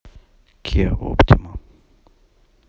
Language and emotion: Russian, neutral